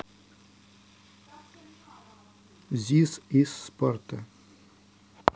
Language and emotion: Russian, neutral